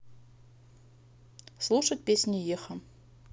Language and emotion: Russian, neutral